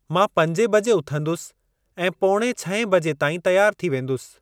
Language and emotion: Sindhi, neutral